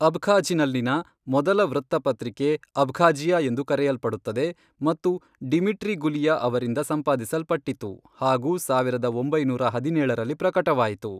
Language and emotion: Kannada, neutral